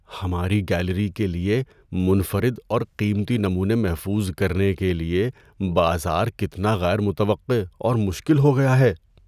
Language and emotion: Urdu, fearful